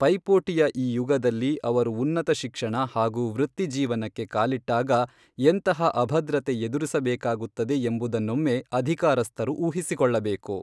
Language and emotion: Kannada, neutral